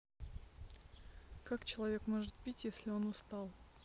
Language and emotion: Russian, neutral